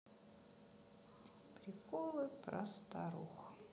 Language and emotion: Russian, sad